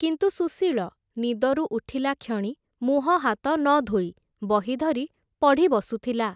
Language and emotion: Odia, neutral